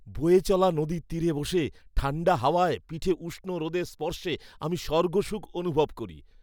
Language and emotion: Bengali, happy